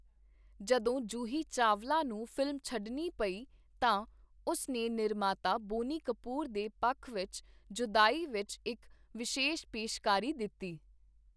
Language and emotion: Punjabi, neutral